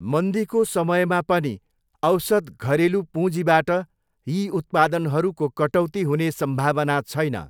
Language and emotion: Nepali, neutral